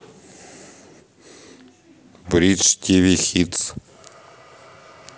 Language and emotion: Russian, neutral